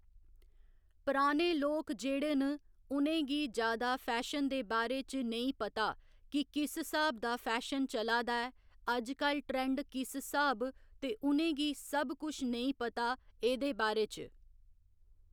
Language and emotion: Dogri, neutral